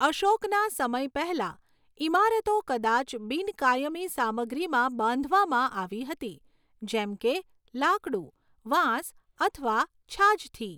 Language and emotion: Gujarati, neutral